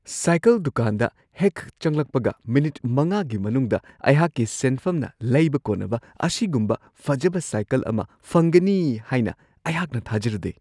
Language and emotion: Manipuri, surprised